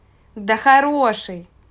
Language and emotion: Russian, positive